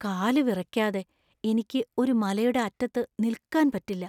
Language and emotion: Malayalam, fearful